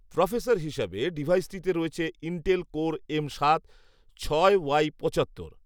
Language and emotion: Bengali, neutral